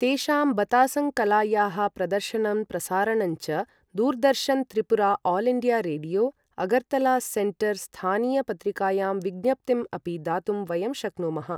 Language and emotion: Sanskrit, neutral